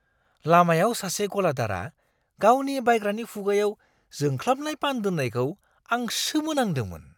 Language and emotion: Bodo, surprised